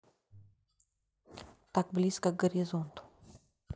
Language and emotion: Russian, neutral